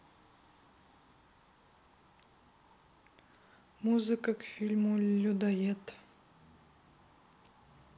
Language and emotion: Russian, neutral